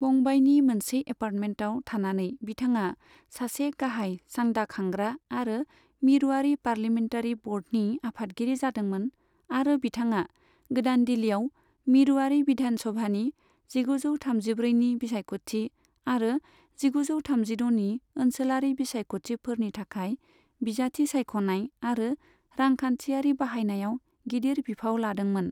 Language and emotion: Bodo, neutral